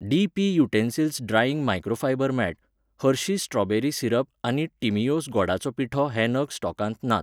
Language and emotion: Goan Konkani, neutral